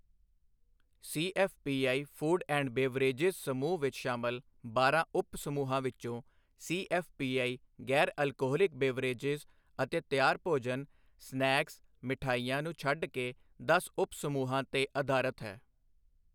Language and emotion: Punjabi, neutral